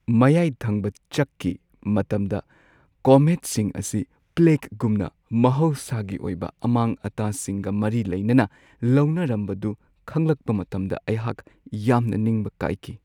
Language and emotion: Manipuri, sad